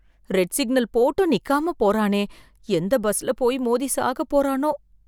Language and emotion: Tamil, fearful